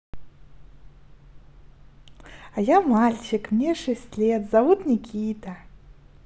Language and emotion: Russian, positive